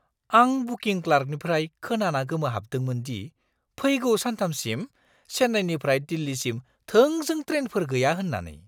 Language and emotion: Bodo, surprised